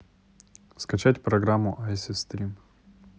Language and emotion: Russian, neutral